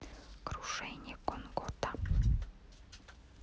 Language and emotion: Russian, neutral